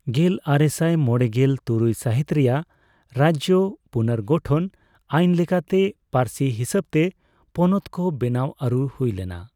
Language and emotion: Santali, neutral